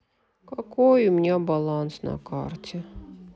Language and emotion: Russian, sad